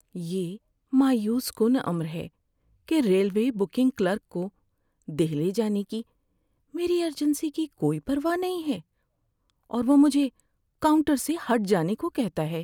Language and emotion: Urdu, sad